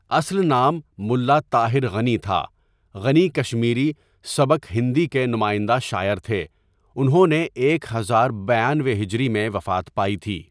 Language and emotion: Urdu, neutral